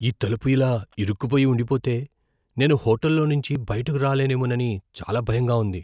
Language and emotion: Telugu, fearful